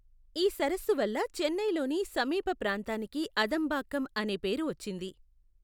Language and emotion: Telugu, neutral